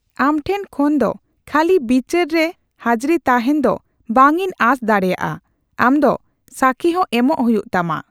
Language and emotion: Santali, neutral